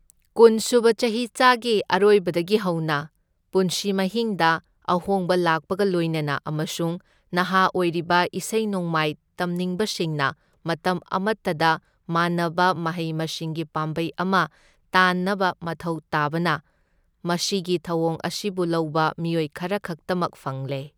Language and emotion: Manipuri, neutral